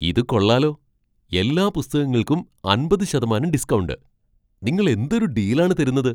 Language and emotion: Malayalam, surprised